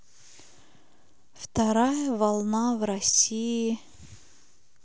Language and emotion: Russian, sad